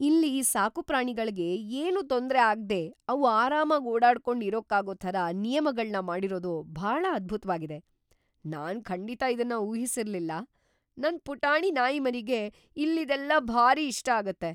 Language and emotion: Kannada, surprised